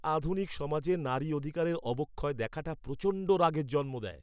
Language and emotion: Bengali, angry